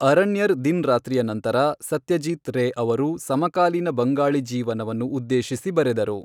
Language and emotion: Kannada, neutral